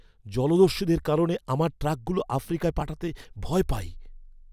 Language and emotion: Bengali, fearful